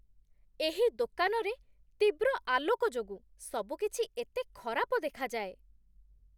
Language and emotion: Odia, disgusted